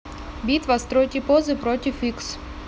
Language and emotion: Russian, neutral